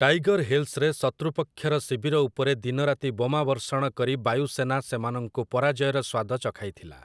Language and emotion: Odia, neutral